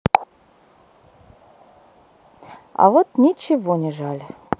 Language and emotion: Russian, neutral